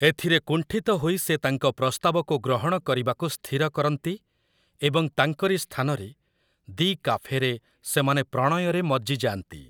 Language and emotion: Odia, neutral